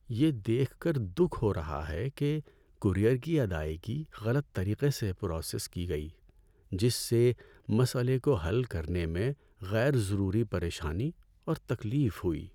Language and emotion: Urdu, sad